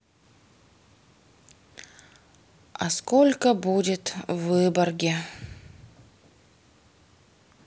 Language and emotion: Russian, sad